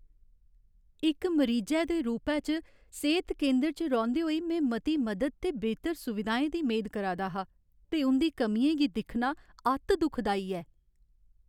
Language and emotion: Dogri, sad